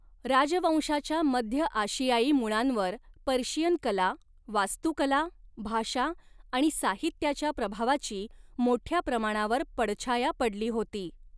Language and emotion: Marathi, neutral